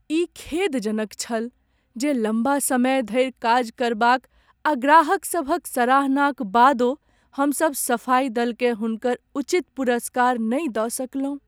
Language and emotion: Maithili, sad